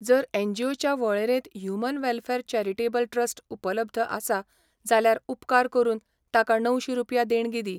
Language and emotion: Goan Konkani, neutral